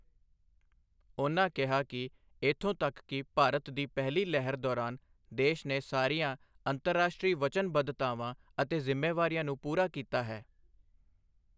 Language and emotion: Punjabi, neutral